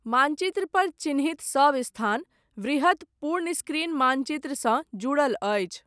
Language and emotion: Maithili, neutral